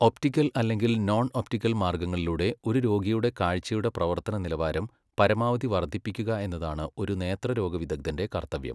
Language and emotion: Malayalam, neutral